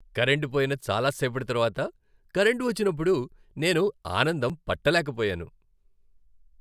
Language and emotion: Telugu, happy